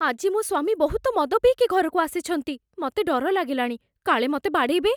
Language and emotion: Odia, fearful